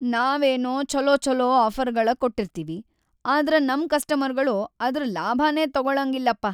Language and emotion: Kannada, sad